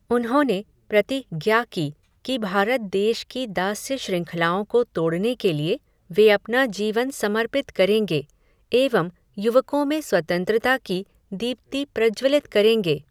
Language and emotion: Hindi, neutral